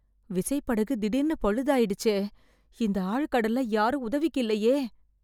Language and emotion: Tamil, fearful